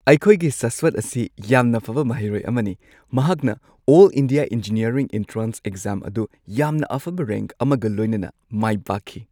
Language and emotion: Manipuri, happy